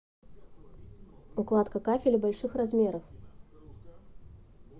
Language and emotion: Russian, neutral